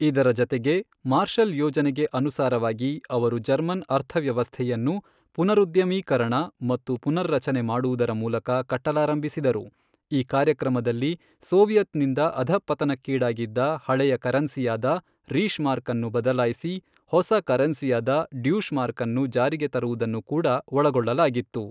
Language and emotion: Kannada, neutral